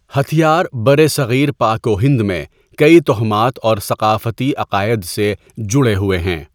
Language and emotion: Urdu, neutral